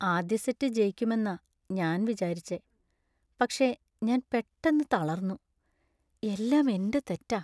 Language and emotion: Malayalam, sad